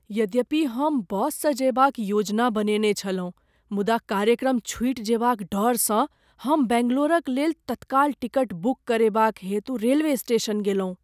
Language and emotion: Maithili, fearful